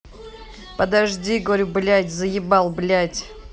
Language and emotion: Russian, angry